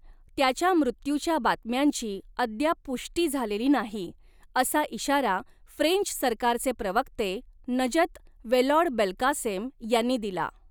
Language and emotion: Marathi, neutral